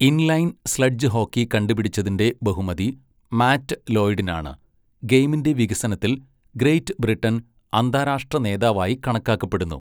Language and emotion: Malayalam, neutral